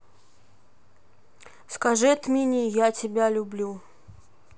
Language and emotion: Russian, neutral